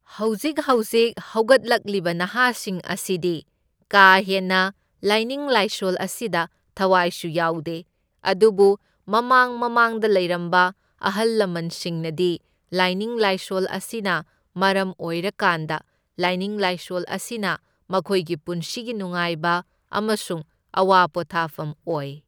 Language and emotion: Manipuri, neutral